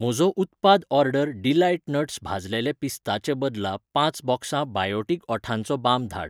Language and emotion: Goan Konkani, neutral